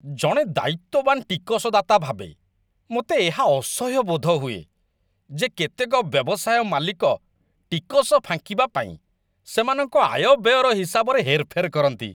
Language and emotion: Odia, disgusted